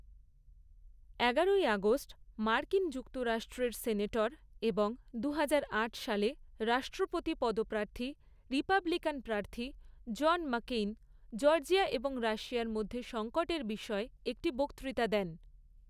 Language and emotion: Bengali, neutral